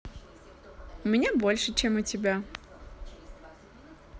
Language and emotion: Russian, positive